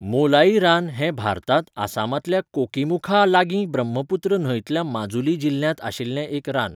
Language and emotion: Goan Konkani, neutral